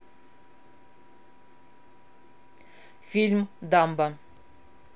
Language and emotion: Russian, neutral